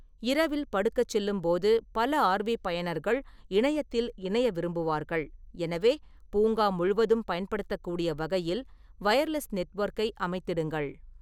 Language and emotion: Tamil, neutral